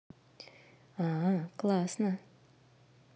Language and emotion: Russian, neutral